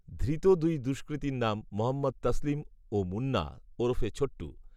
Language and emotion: Bengali, neutral